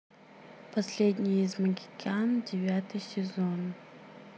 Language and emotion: Russian, neutral